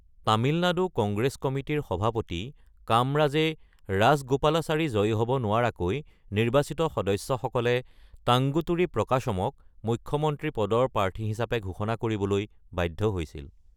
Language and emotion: Assamese, neutral